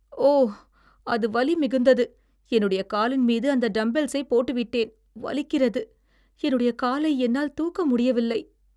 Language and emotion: Tamil, sad